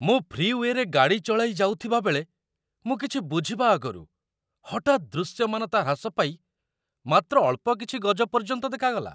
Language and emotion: Odia, surprised